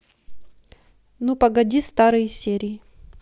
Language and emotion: Russian, neutral